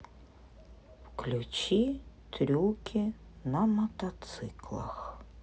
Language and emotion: Russian, neutral